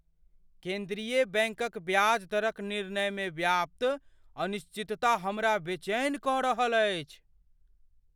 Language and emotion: Maithili, fearful